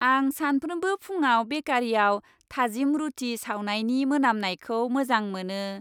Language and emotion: Bodo, happy